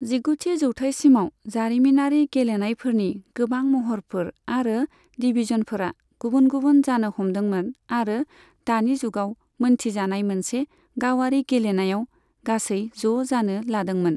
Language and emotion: Bodo, neutral